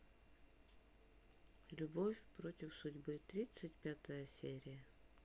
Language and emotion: Russian, neutral